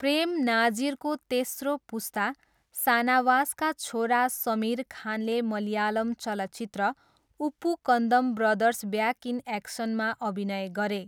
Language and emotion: Nepali, neutral